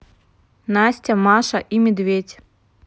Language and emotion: Russian, neutral